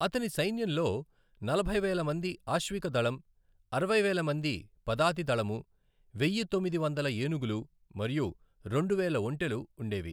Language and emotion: Telugu, neutral